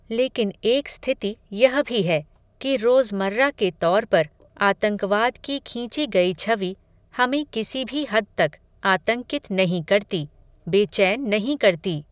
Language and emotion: Hindi, neutral